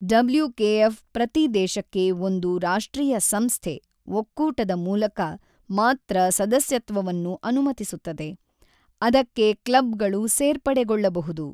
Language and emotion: Kannada, neutral